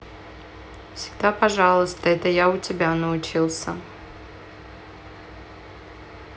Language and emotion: Russian, neutral